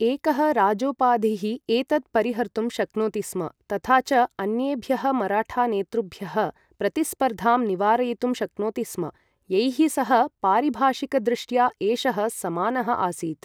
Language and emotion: Sanskrit, neutral